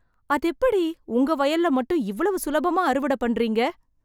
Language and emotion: Tamil, surprised